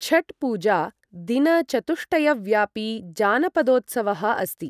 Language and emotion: Sanskrit, neutral